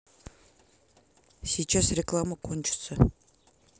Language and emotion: Russian, neutral